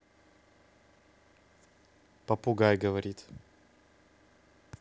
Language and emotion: Russian, neutral